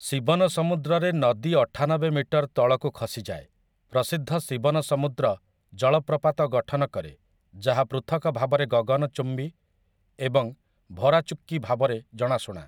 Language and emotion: Odia, neutral